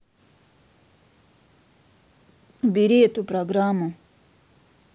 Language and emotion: Russian, neutral